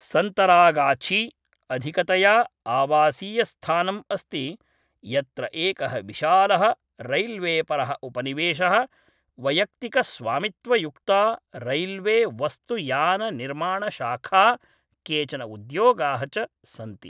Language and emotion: Sanskrit, neutral